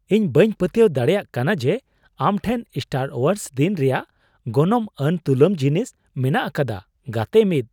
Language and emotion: Santali, surprised